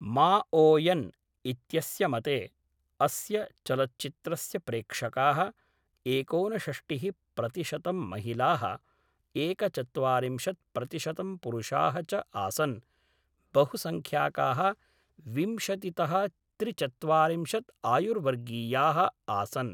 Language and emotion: Sanskrit, neutral